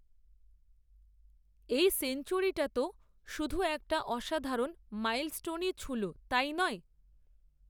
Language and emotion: Bengali, neutral